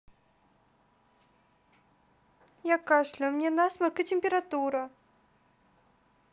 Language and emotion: Russian, sad